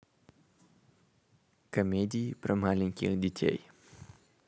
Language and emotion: Russian, neutral